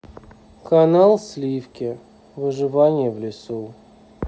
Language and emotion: Russian, neutral